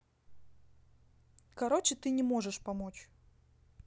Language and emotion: Russian, neutral